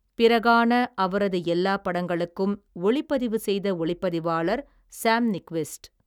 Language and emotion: Tamil, neutral